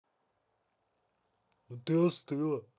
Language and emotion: Russian, neutral